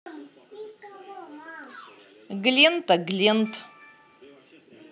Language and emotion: Russian, positive